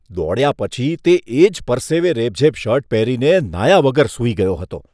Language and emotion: Gujarati, disgusted